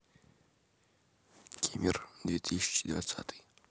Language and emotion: Russian, neutral